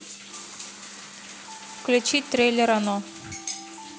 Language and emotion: Russian, neutral